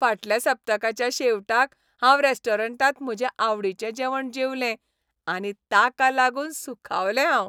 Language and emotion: Goan Konkani, happy